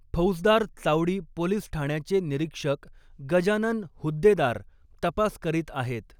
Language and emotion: Marathi, neutral